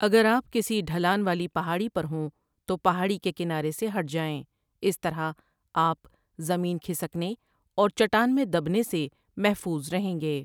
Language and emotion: Urdu, neutral